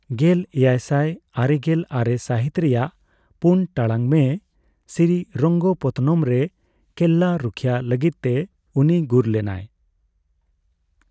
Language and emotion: Santali, neutral